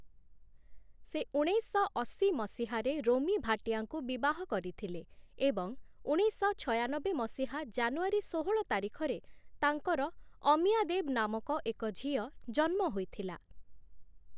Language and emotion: Odia, neutral